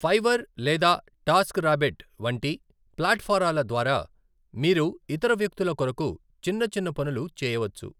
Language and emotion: Telugu, neutral